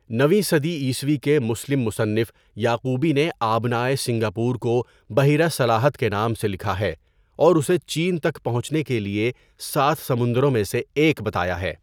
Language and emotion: Urdu, neutral